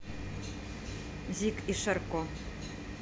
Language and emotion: Russian, neutral